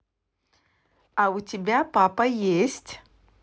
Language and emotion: Russian, positive